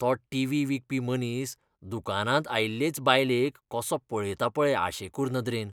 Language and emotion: Goan Konkani, disgusted